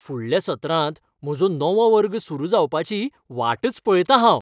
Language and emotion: Goan Konkani, happy